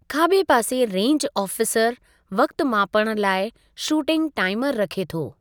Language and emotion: Sindhi, neutral